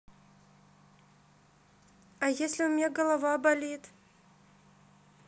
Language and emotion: Russian, sad